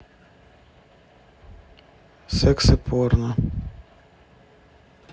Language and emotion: Russian, neutral